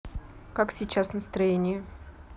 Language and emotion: Russian, neutral